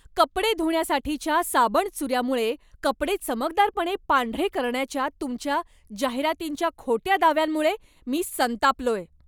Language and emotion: Marathi, angry